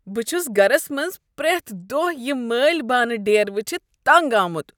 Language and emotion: Kashmiri, disgusted